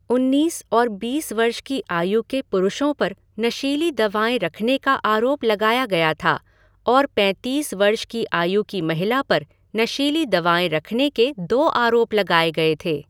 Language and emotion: Hindi, neutral